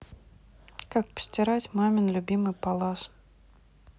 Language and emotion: Russian, neutral